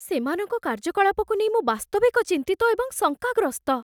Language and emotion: Odia, fearful